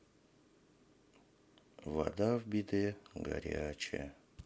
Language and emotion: Russian, sad